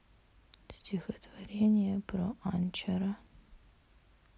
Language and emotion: Russian, sad